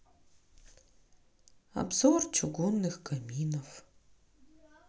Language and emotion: Russian, sad